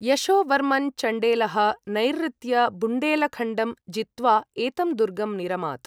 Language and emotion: Sanskrit, neutral